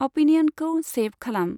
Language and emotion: Bodo, neutral